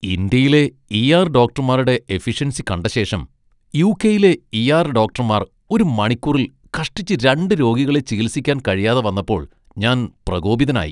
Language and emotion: Malayalam, disgusted